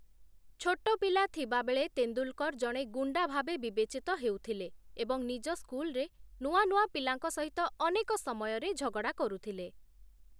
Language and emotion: Odia, neutral